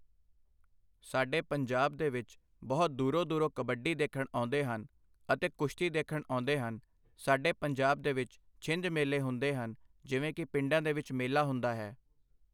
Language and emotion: Punjabi, neutral